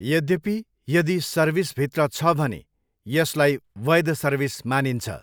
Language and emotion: Nepali, neutral